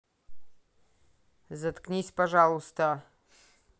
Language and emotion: Russian, angry